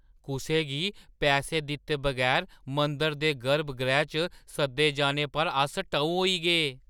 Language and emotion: Dogri, surprised